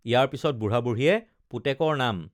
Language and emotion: Assamese, neutral